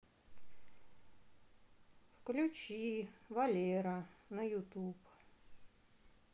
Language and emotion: Russian, sad